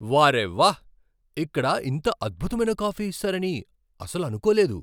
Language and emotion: Telugu, surprised